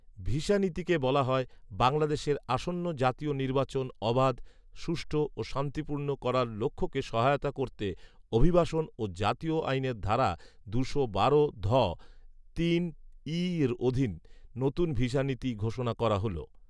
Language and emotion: Bengali, neutral